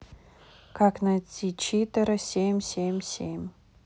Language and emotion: Russian, neutral